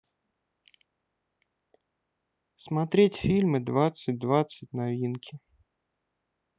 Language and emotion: Russian, neutral